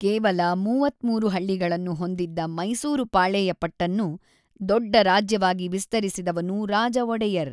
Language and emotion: Kannada, neutral